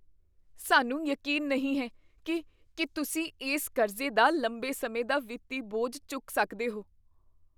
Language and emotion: Punjabi, fearful